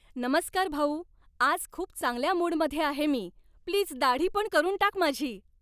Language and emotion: Marathi, happy